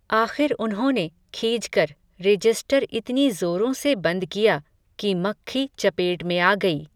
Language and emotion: Hindi, neutral